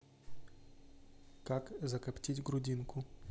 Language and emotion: Russian, neutral